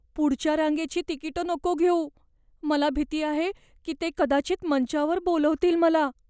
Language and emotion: Marathi, fearful